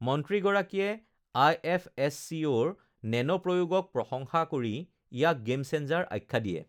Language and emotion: Assamese, neutral